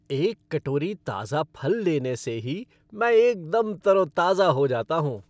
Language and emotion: Hindi, happy